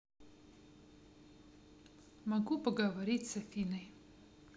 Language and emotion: Russian, neutral